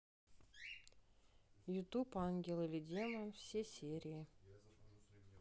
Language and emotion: Russian, neutral